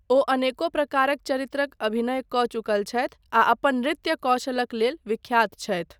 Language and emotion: Maithili, neutral